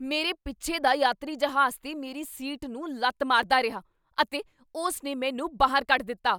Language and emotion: Punjabi, angry